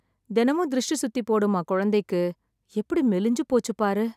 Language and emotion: Tamil, sad